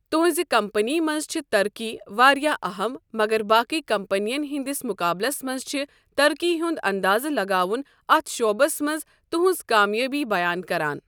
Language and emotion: Kashmiri, neutral